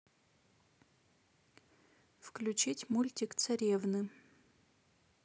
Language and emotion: Russian, neutral